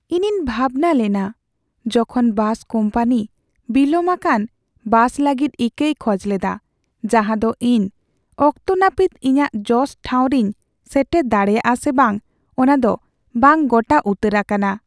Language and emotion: Santali, sad